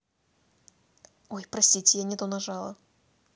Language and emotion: Russian, neutral